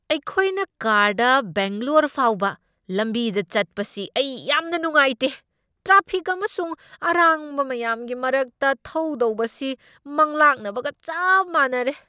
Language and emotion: Manipuri, angry